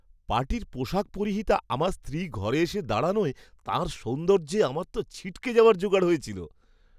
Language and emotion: Bengali, surprised